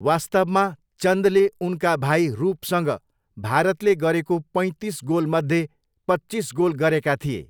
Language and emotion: Nepali, neutral